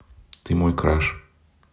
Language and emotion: Russian, neutral